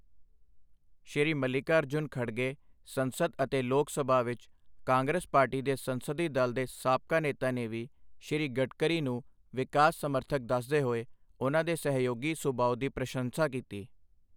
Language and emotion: Punjabi, neutral